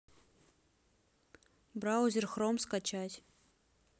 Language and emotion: Russian, neutral